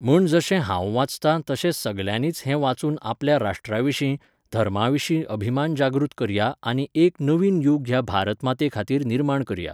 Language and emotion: Goan Konkani, neutral